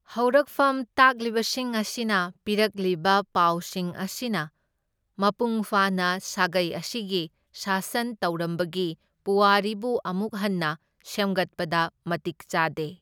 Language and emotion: Manipuri, neutral